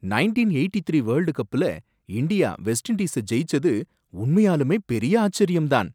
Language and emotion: Tamil, surprised